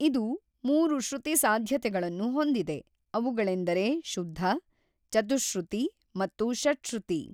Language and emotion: Kannada, neutral